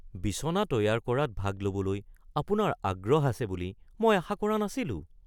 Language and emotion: Assamese, surprised